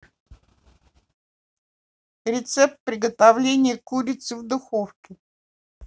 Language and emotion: Russian, neutral